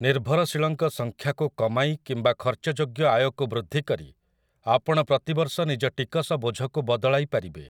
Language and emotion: Odia, neutral